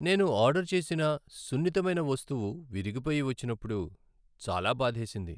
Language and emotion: Telugu, sad